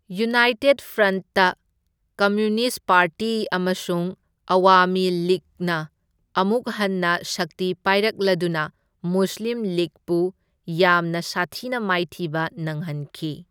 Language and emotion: Manipuri, neutral